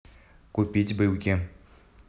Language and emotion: Russian, neutral